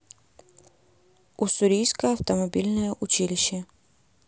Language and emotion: Russian, neutral